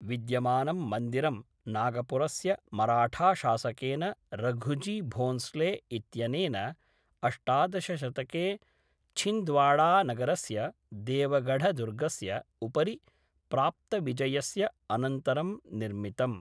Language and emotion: Sanskrit, neutral